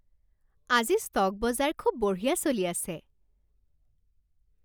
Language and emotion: Assamese, happy